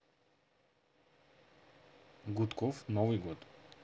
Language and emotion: Russian, neutral